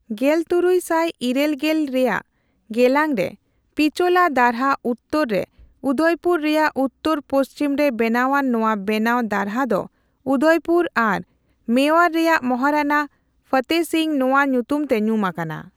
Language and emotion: Santali, neutral